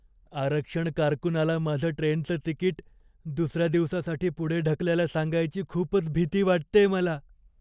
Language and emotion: Marathi, fearful